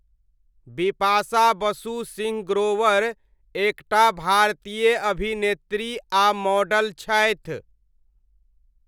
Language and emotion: Maithili, neutral